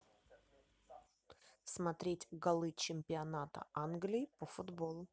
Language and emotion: Russian, neutral